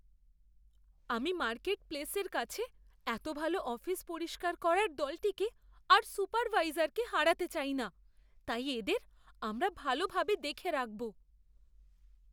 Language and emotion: Bengali, fearful